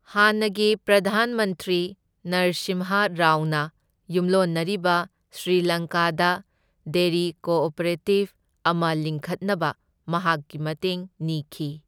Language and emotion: Manipuri, neutral